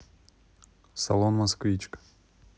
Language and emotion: Russian, neutral